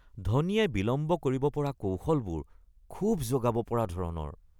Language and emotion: Assamese, disgusted